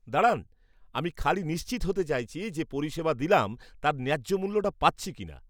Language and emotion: Bengali, disgusted